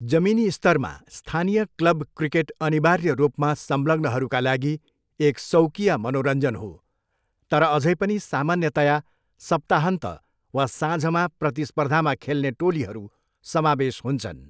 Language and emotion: Nepali, neutral